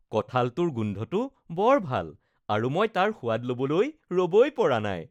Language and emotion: Assamese, happy